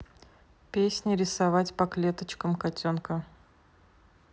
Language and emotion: Russian, neutral